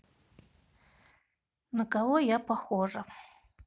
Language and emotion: Russian, sad